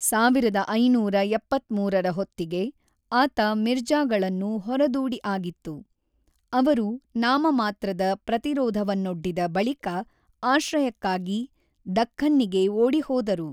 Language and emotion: Kannada, neutral